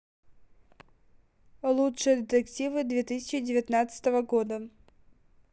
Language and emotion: Russian, neutral